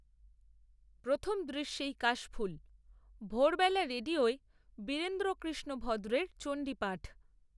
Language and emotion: Bengali, neutral